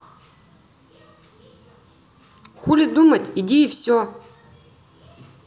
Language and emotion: Russian, angry